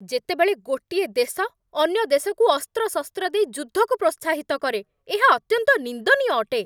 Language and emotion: Odia, angry